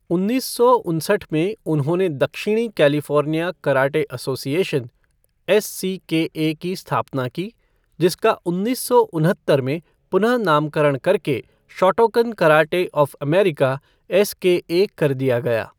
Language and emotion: Hindi, neutral